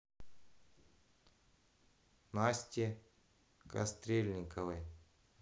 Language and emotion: Russian, neutral